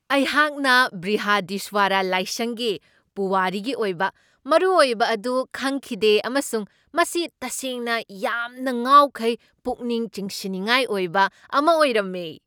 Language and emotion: Manipuri, surprised